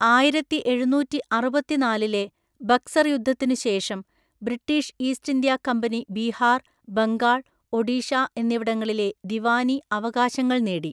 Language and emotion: Malayalam, neutral